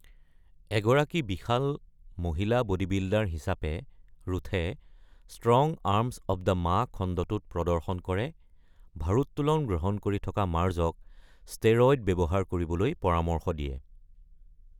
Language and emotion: Assamese, neutral